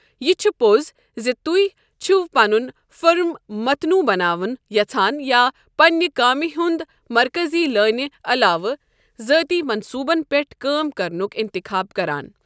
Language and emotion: Kashmiri, neutral